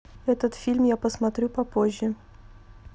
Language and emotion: Russian, neutral